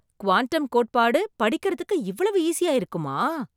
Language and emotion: Tamil, surprised